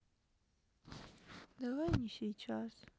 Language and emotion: Russian, sad